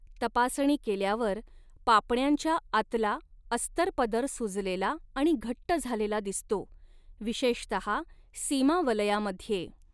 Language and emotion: Marathi, neutral